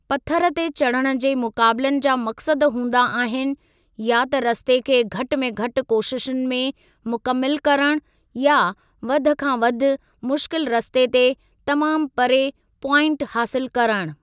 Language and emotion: Sindhi, neutral